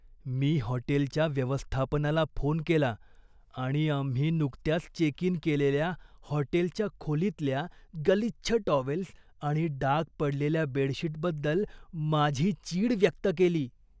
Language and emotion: Marathi, disgusted